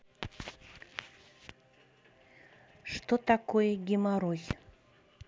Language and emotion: Russian, neutral